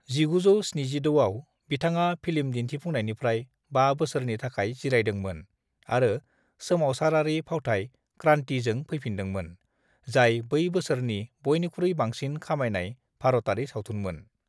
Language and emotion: Bodo, neutral